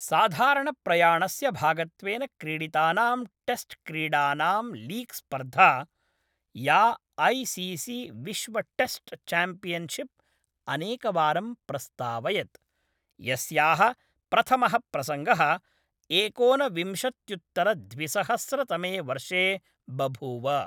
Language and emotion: Sanskrit, neutral